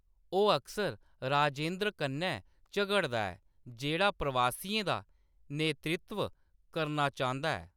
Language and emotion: Dogri, neutral